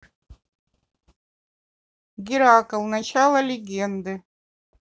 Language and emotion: Russian, neutral